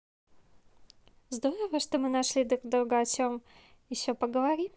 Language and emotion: Russian, positive